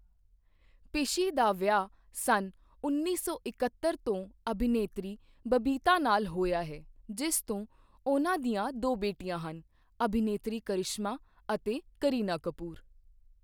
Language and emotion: Punjabi, neutral